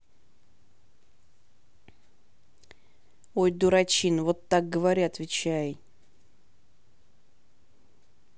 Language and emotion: Russian, neutral